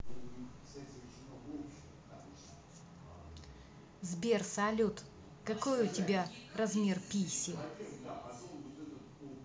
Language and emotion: Russian, neutral